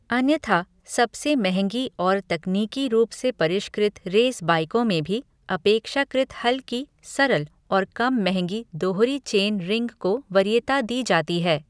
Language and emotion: Hindi, neutral